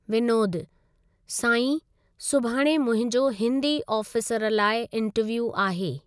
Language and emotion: Sindhi, neutral